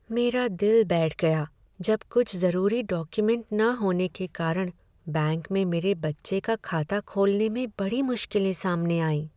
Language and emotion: Hindi, sad